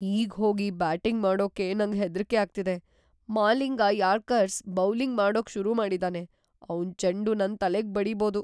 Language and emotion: Kannada, fearful